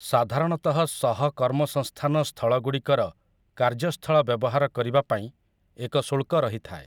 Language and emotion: Odia, neutral